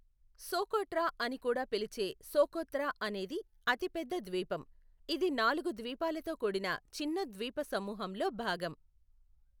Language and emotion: Telugu, neutral